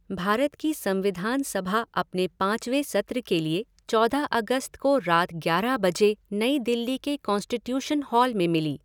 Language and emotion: Hindi, neutral